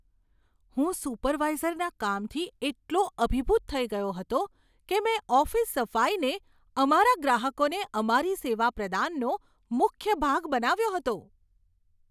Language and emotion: Gujarati, surprised